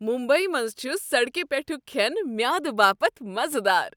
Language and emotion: Kashmiri, happy